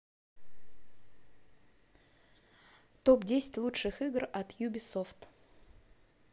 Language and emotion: Russian, neutral